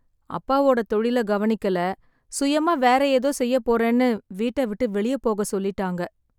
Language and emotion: Tamil, sad